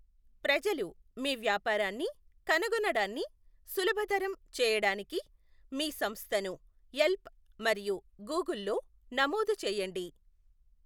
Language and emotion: Telugu, neutral